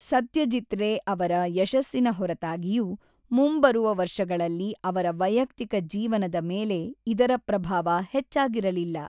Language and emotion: Kannada, neutral